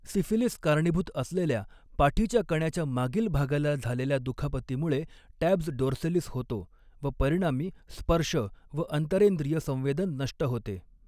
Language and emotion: Marathi, neutral